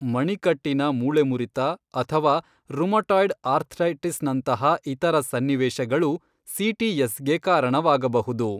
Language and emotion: Kannada, neutral